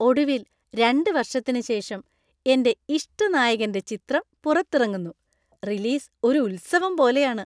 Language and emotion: Malayalam, happy